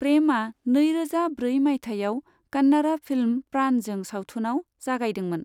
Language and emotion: Bodo, neutral